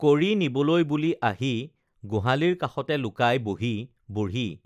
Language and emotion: Assamese, neutral